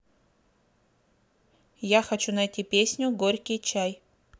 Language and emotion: Russian, neutral